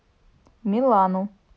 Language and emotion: Russian, neutral